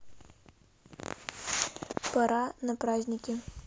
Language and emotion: Russian, neutral